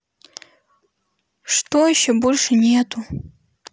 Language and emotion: Russian, sad